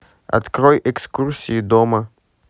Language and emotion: Russian, neutral